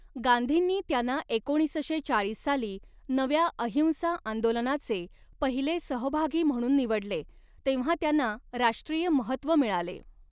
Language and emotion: Marathi, neutral